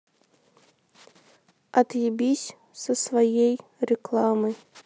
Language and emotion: Russian, neutral